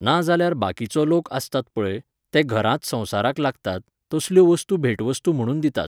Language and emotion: Goan Konkani, neutral